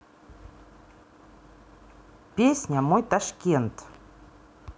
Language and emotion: Russian, neutral